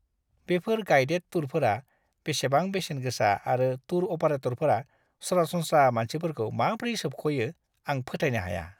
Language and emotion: Bodo, disgusted